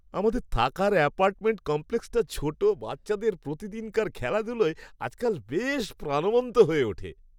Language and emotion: Bengali, happy